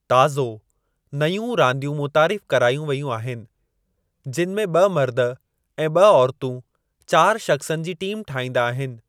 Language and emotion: Sindhi, neutral